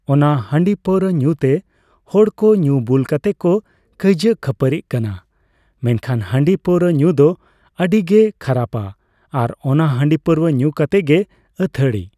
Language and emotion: Santali, neutral